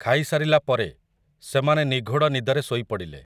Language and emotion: Odia, neutral